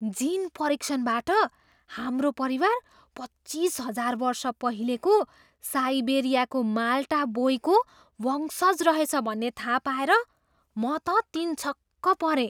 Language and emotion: Nepali, surprised